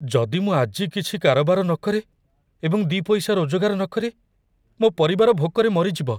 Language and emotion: Odia, fearful